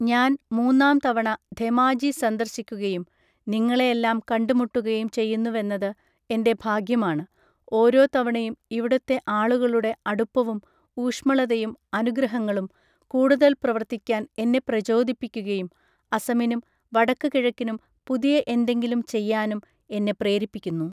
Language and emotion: Malayalam, neutral